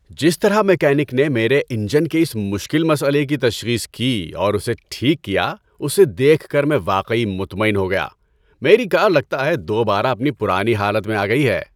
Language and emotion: Urdu, happy